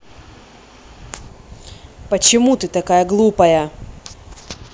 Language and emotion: Russian, angry